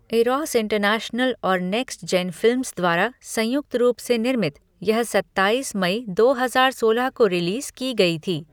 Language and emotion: Hindi, neutral